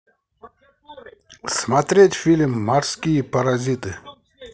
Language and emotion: Russian, positive